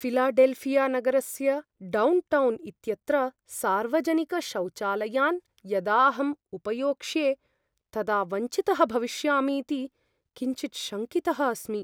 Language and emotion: Sanskrit, fearful